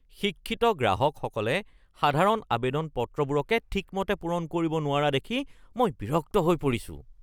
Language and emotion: Assamese, disgusted